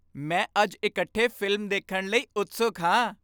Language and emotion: Punjabi, happy